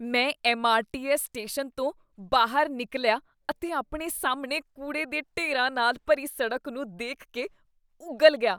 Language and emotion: Punjabi, disgusted